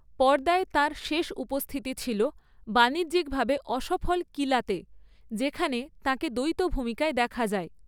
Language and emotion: Bengali, neutral